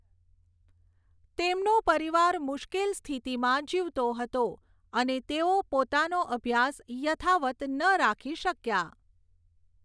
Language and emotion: Gujarati, neutral